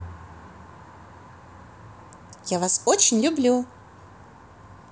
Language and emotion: Russian, positive